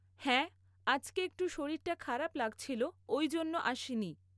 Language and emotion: Bengali, neutral